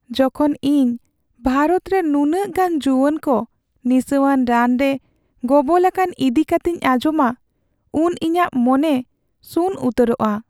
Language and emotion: Santali, sad